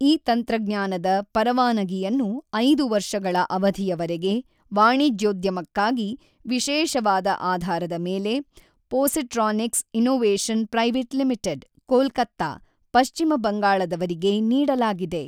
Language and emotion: Kannada, neutral